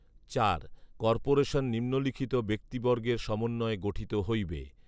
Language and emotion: Bengali, neutral